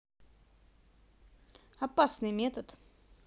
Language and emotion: Russian, neutral